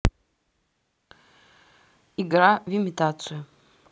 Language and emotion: Russian, neutral